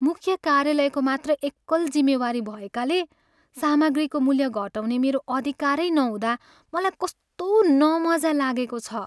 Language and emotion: Nepali, sad